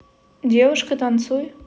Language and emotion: Russian, neutral